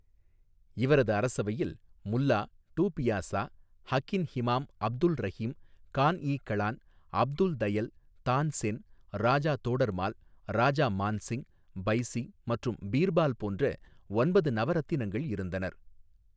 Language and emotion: Tamil, neutral